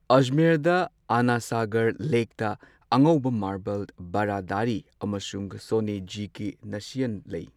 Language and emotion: Manipuri, neutral